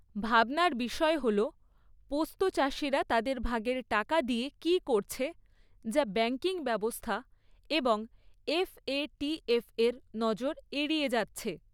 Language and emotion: Bengali, neutral